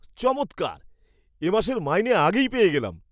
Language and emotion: Bengali, surprised